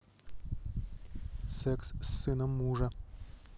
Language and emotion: Russian, neutral